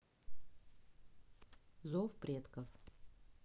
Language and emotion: Russian, neutral